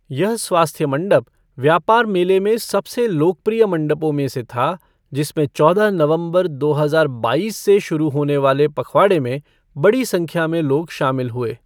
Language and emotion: Hindi, neutral